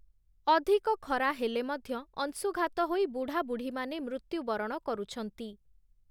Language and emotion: Odia, neutral